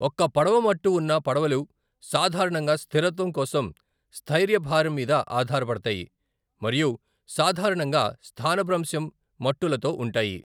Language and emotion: Telugu, neutral